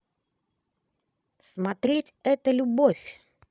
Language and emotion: Russian, positive